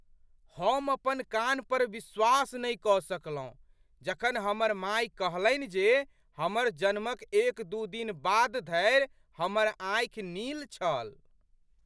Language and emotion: Maithili, surprised